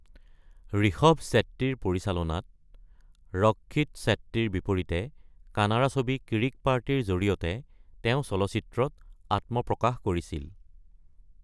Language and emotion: Assamese, neutral